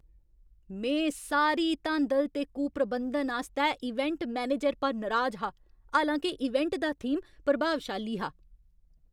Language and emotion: Dogri, angry